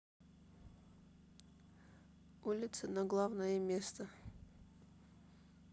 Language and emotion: Russian, neutral